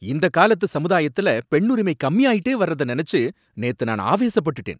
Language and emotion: Tamil, angry